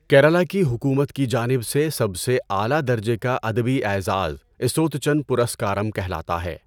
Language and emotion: Urdu, neutral